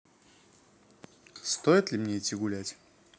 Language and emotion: Russian, neutral